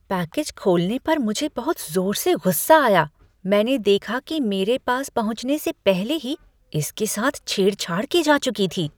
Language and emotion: Hindi, disgusted